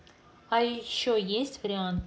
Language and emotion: Russian, neutral